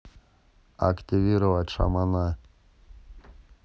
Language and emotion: Russian, neutral